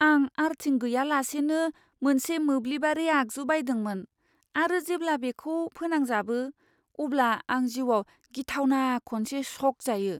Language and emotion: Bodo, fearful